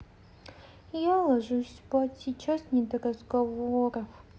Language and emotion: Russian, sad